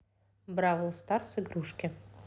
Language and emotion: Russian, neutral